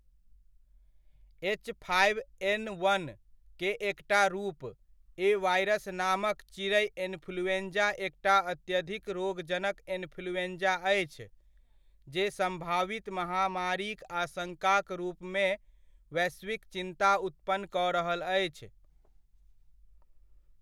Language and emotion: Maithili, neutral